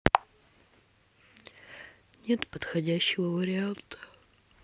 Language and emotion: Russian, sad